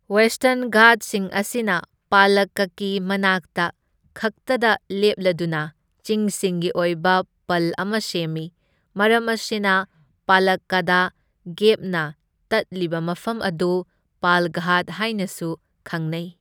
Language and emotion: Manipuri, neutral